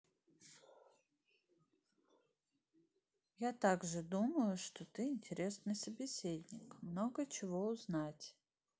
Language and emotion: Russian, neutral